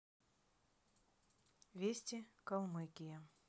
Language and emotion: Russian, neutral